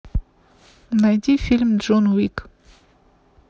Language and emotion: Russian, neutral